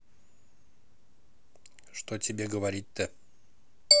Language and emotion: Russian, neutral